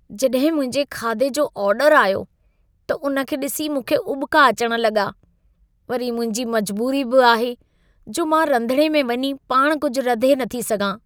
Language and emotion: Sindhi, disgusted